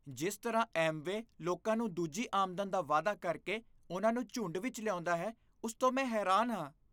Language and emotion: Punjabi, disgusted